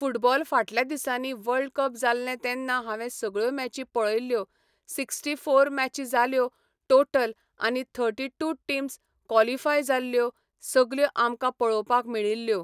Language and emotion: Goan Konkani, neutral